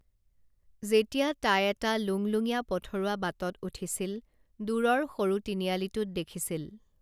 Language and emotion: Assamese, neutral